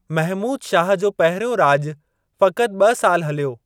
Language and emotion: Sindhi, neutral